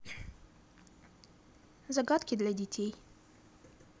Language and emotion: Russian, neutral